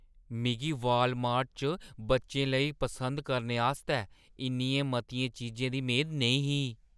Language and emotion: Dogri, surprised